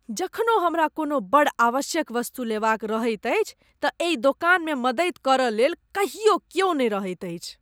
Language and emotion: Maithili, disgusted